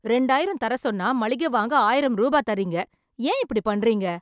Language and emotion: Tamil, angry